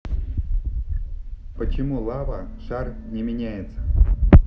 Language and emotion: Russian, neutral